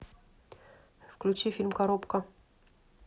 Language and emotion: Russian, neutral